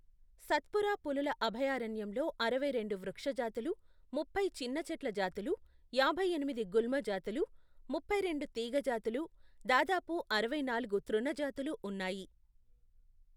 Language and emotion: Telugu, neutral